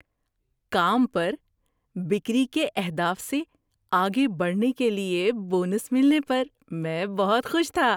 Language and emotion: Urdu, happy